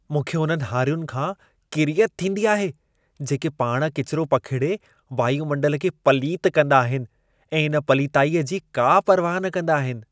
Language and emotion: Sindhi, disgusted